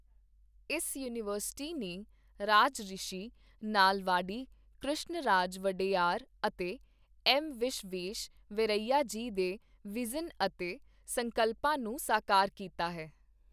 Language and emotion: Punjabi, neutral